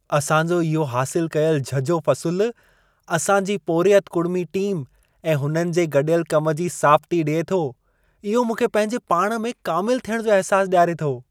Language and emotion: Sindhi, happy